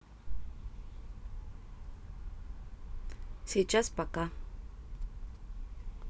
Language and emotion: Russian, neutral